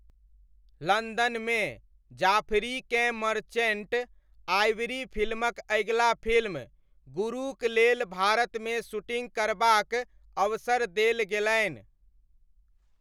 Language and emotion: Maithili, neutral